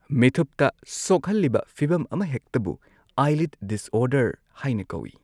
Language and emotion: Manipuri, neutral